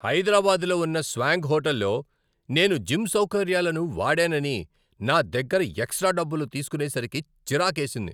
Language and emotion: Telugu, angry